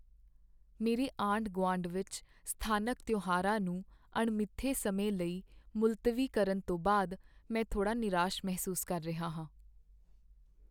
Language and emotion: Punjabi, sad